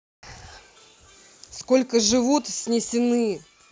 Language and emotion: Russian, angry